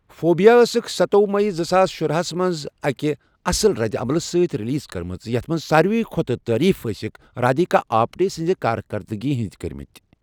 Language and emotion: Kashmiri, neutral